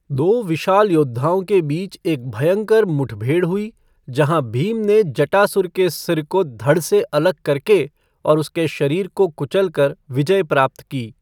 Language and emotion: Hindi, neutral